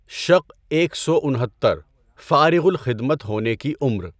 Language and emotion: Urdu, neutral